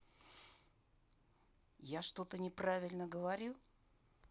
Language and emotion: Russian, angry